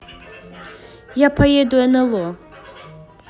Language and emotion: Russian, neutral